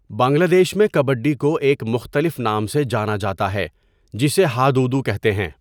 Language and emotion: Urdu, neutral